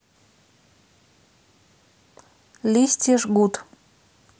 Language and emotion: Russian, neutral